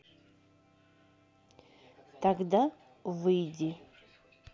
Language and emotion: Russian, neutral